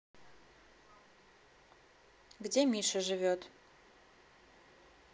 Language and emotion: Russian, neutral